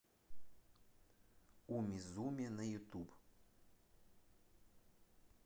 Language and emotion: Russian, neutral